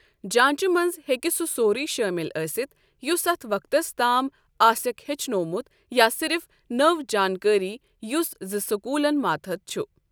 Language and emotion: Kashmiri, neutral